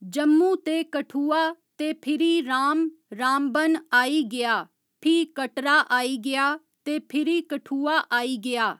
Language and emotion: Dogri, neutral